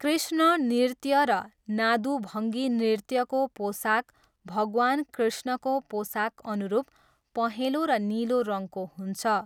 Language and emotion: Nepali, neutral